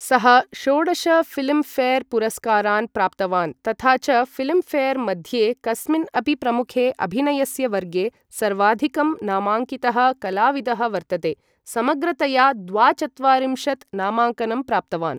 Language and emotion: Sanskrit, neutral